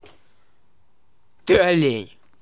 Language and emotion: Russian, angry